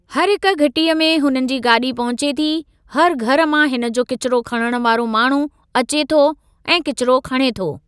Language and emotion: Sindhi, neutral